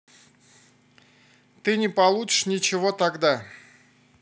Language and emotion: Russian, neutral